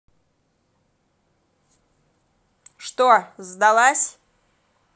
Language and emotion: Russian, angry